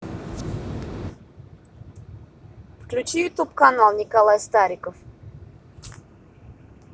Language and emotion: Russian, neutral